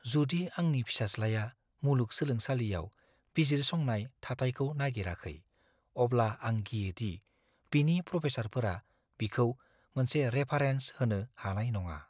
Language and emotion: Bodo, fearful